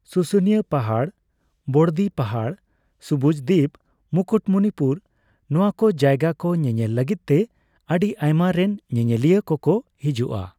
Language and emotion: Santali, neutral